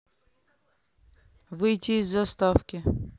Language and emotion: Russian, neutral